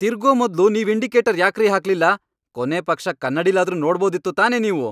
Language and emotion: Kannada, angry